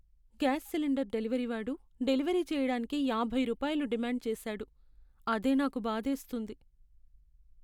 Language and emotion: Telugu, sad